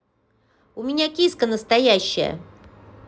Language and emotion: Russian, positive